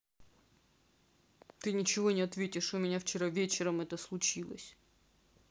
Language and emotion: Russian, sad